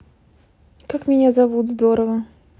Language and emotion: Russian, neutral